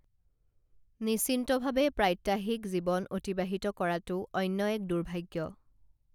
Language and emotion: Assamese, neutral